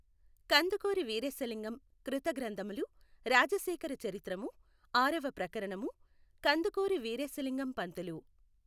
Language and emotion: Telugu, neutral